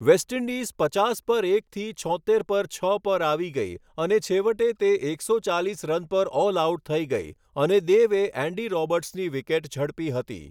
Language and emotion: Gujarati, neutral